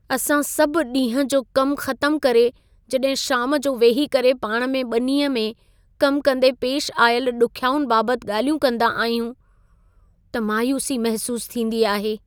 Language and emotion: Sindhi, sad